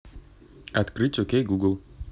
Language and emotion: Russian, neutral